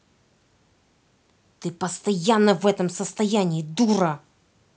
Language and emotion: Russian, angry